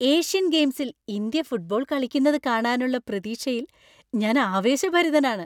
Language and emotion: Malayalam, happy